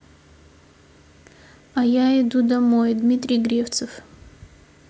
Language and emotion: Russian, neutral